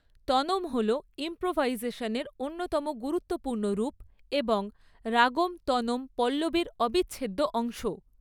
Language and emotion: Bengali, neutral